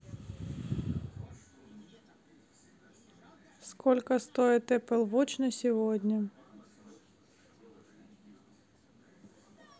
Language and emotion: Russian, neutral